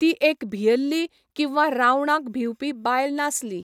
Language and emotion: Goan Konkani, neutral